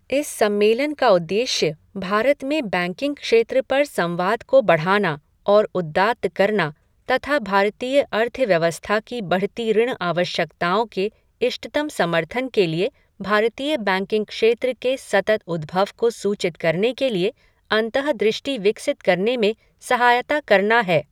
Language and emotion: Hindi, neutral